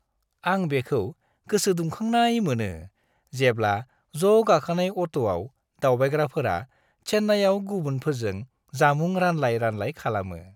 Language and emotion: Bodo, happy